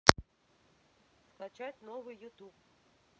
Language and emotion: Russian, neutral